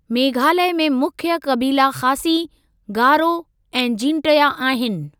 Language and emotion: Sindhi, neutral